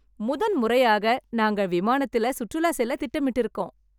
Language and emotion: Tamil, happy